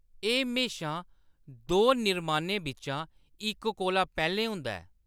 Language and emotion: Dogri, neutral